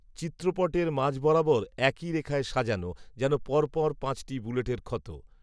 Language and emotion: Bengali, neutral